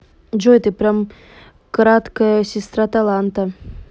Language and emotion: Russian, neutral